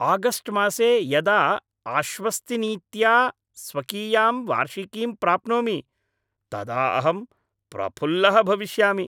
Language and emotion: Sanskrit, happy